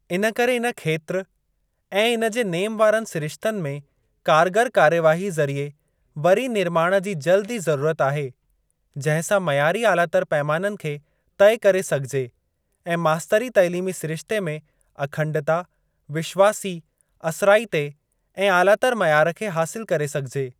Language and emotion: Sindhi, neutral